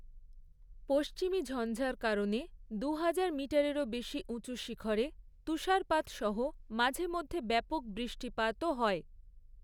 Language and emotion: Bengali, neutral